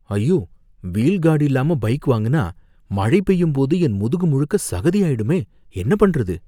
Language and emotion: Tamil, fearful